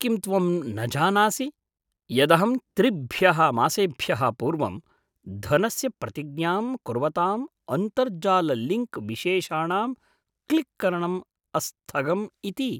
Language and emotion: Sanskrit, surprised